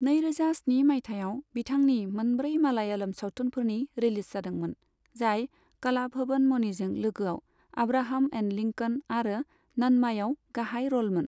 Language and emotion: Bodo, neutral